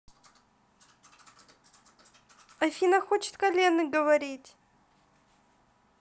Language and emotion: Russian, neutral